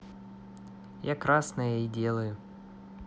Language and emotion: Russian, neutral